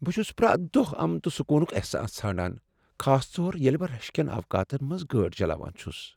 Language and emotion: Kashmiri, sad